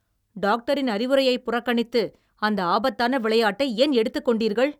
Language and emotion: Tamil, angry